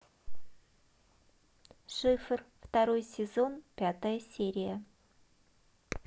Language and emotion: Russian, neutral